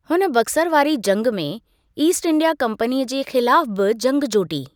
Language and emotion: Sindhi, neutral